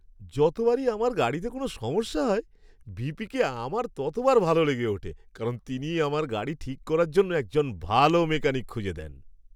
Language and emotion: Bengali, happy